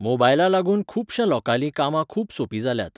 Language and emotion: Goan Konkani, neutral